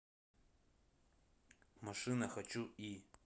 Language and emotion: Russian, neutral